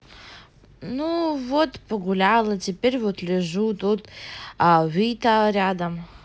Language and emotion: Russian, neutral